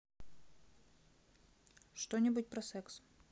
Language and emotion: Russian, neutral